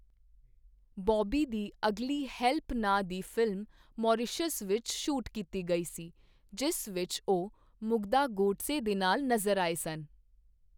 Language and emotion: Punjabi, neutral